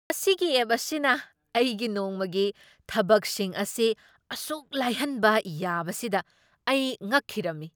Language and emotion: Manipuri, surprised